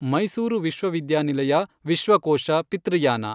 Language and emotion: Kannada, neutral